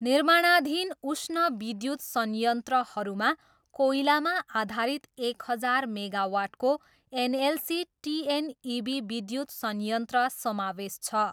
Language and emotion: Nepali, neutral